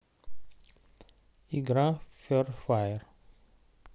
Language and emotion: Russian, neutral